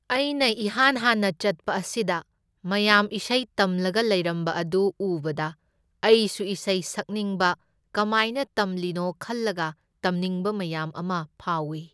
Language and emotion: Manipuri, neutral